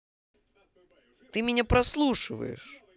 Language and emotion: Russian, angry